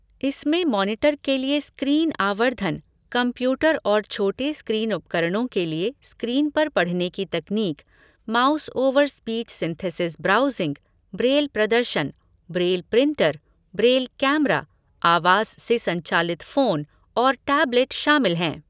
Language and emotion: Hindi, neutral